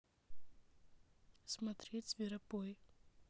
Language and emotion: Russian, neutral